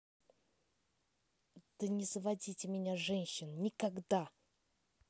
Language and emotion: Russian, angry